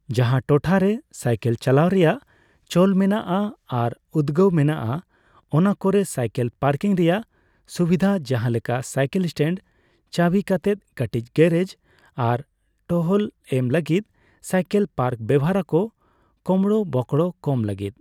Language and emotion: Santali, neutral